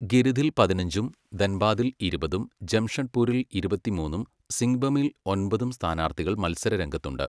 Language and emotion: Malayalam, neutral